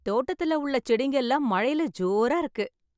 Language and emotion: Tamil, happy